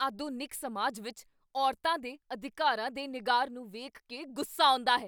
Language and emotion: Punjabi, angry